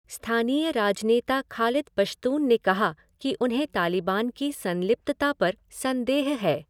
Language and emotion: Hindi, neutral